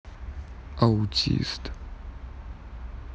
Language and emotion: Russian, neutral